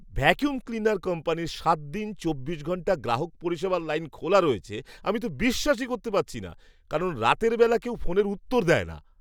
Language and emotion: Bengali, surprised